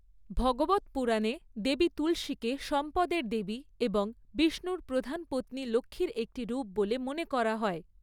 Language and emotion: Bengali, neutral